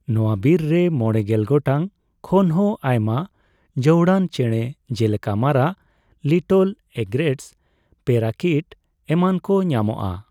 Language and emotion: Santali, neutral